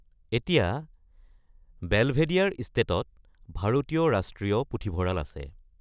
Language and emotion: Assamese, neutral